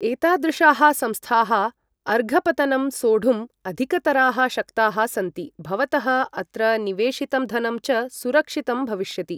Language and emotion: Sanskrit, neutral